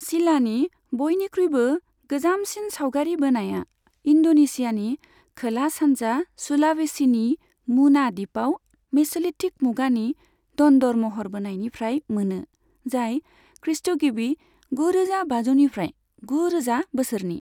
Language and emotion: Bodo, neutral